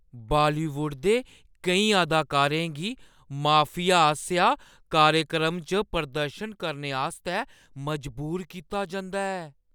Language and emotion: Dogri, fearful